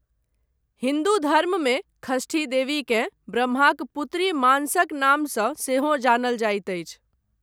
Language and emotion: Maithili, neutral